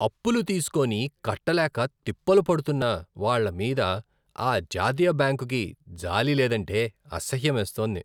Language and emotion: Telugu, disgusted